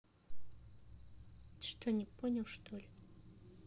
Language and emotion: Russian, neutral